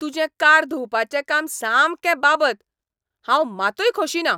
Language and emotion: Goan Konkani, angry